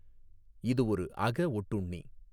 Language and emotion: Tamil, neutral